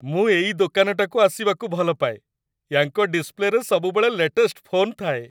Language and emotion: Odia, happy